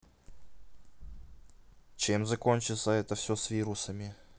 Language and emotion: Russian, neutral